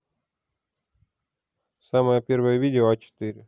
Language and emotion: Russian, neutral